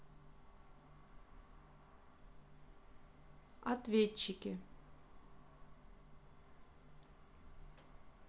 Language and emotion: Russian, neutral